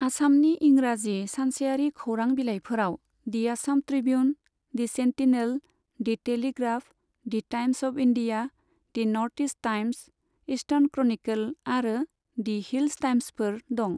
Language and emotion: Bodo, neutral